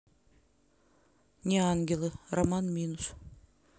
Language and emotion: Russian, neutral